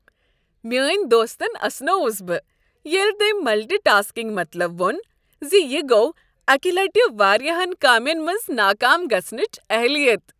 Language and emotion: Kashmiri, happy